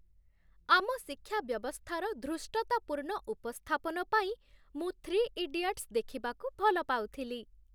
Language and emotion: Odia, happy